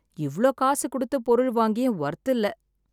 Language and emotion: Tamil, sad